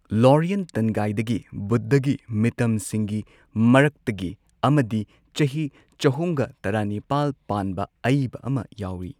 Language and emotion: Manipuri, neutral